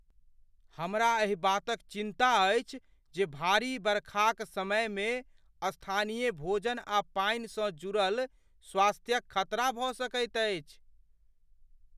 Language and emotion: Maithili, fearful